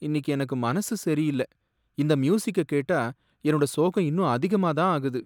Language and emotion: Tamil, sad